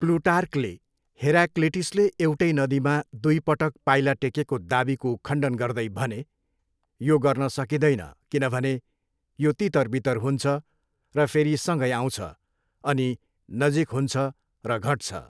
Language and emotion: Nepali, neutral